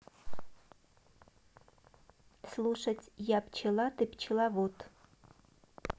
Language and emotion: Russian, neutral